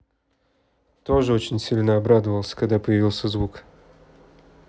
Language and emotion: Russian, neutral